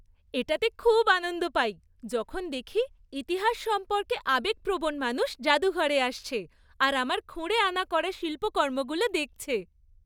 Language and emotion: Bengali, happy